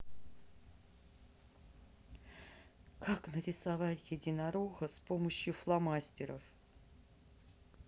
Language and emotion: Russian, neutral